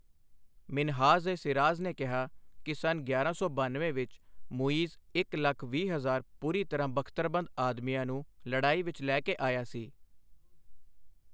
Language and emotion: Punjabi, neutral